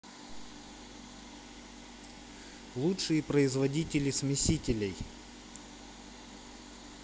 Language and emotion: Russian, neutral